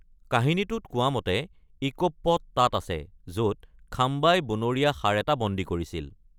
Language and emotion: Assamese, neutral